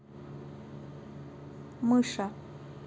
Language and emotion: Russian, neutral